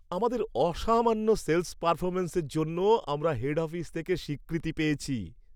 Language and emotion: Bengali, happy